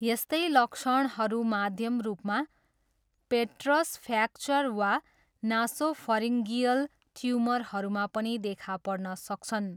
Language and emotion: Nepali, neutral